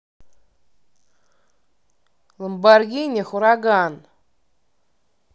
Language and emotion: Russian, angry